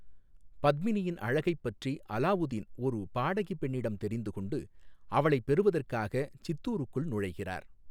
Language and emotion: Tamil, neutral